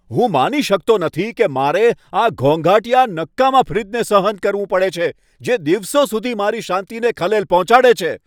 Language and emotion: Gujarati, angry